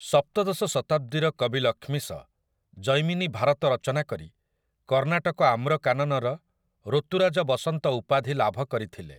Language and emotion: Odia, neutral